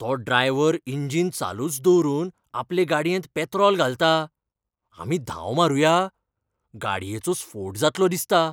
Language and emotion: Goan Konkani, fearful